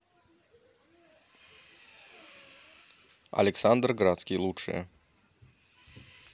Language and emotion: Russian, neutral